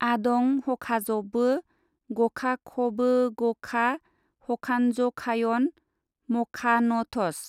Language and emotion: Bodo, neutral